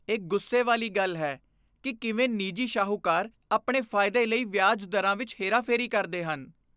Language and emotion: Punjabi, disgusted